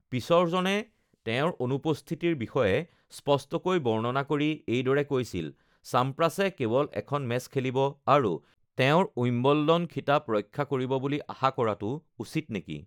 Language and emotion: Assamese, neutral